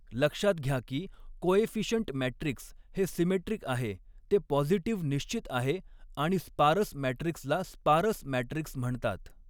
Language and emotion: Marathi, neutral